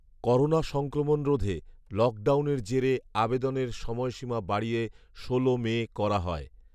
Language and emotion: Bengali, neutral